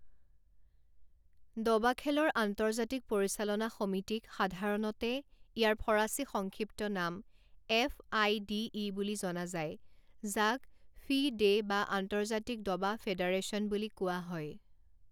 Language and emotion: Assamese, neutral